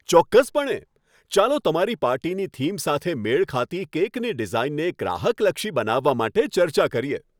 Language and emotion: Gujarati, happy